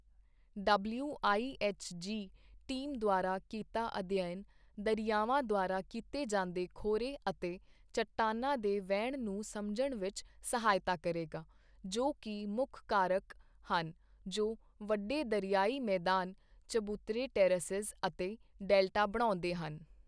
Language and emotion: Punjabi, neutral